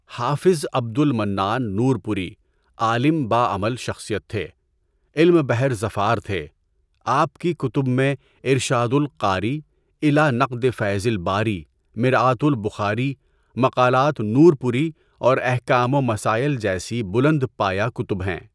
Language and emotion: Urdu, neutral